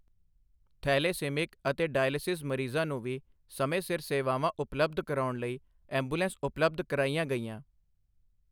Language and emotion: Punjabi, neutral